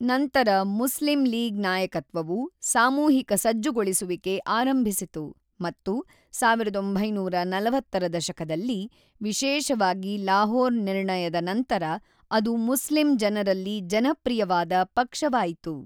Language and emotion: Kannada, neutral